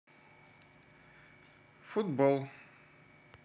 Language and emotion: Russian, neutral